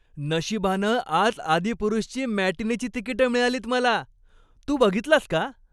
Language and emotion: Marathi, happy